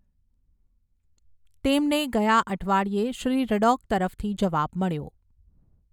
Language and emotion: Gujarati, neutral